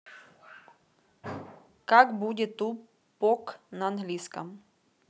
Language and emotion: Russian, neutral